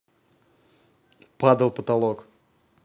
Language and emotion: Russian, neutral